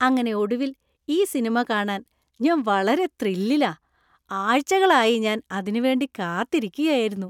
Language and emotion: Malayalam, happy